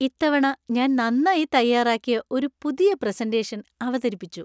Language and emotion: Malayalam, happy